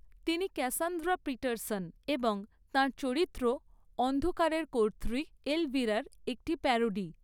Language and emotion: Bengali, neutral